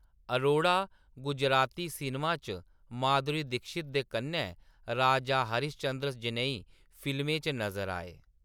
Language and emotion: Dogri, neutral